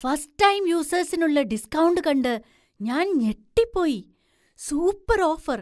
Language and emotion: Malayalam, surprised